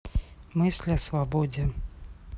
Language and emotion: Russian, neutral